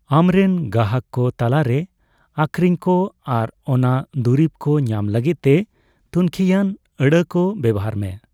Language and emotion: Santali, neutral